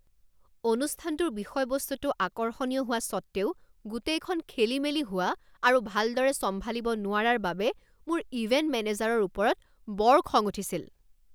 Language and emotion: Assamese, angry